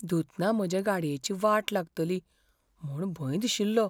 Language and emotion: Goan Konkani, fearful